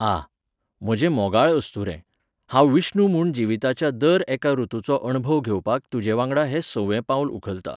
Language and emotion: Goan Konkani, neutral